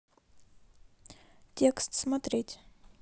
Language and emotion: Russian, neutral